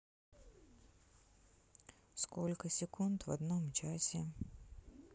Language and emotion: Russian, neutral